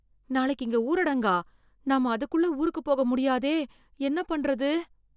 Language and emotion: Tamil, fearful